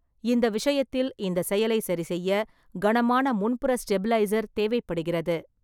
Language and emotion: Tamil, neutral